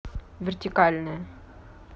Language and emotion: Russian, neutral